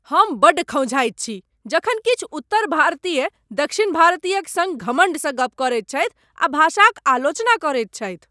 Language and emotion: Maithili, angry